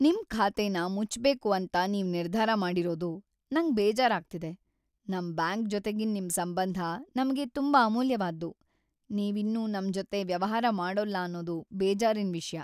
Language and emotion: Kannada, sad